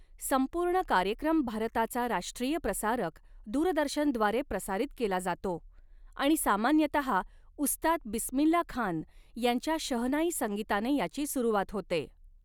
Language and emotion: Marathi, neutral